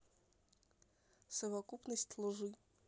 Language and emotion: Russian, neutral